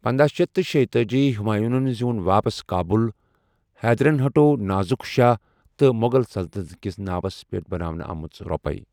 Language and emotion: Kashmiri, neutral